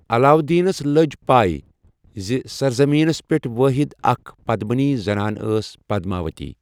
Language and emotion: Kashmiri, neutral